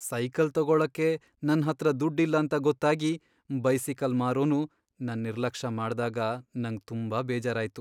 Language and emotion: Kannada, sad